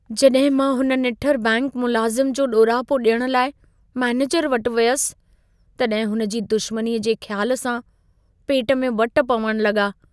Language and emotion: Sindhi, fearful